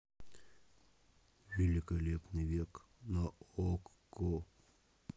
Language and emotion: Russian, neutral